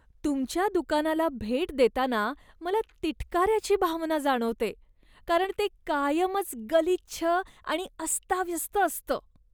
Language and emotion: Marathi, disgusted